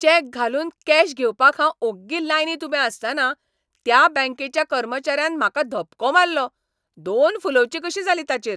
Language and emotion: Goan Konkani, angry